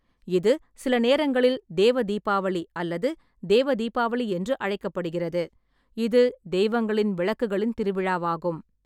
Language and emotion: Tamil, neutral